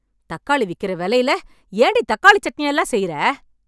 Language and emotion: Tamil, angry